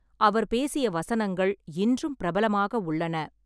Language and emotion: Tamil, neutral